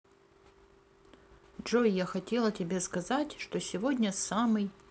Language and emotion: Russian, neutral